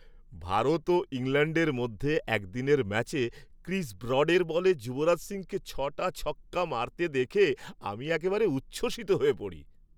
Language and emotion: Bengali, happy